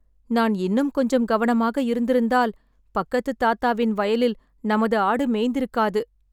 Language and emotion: Tamil, sad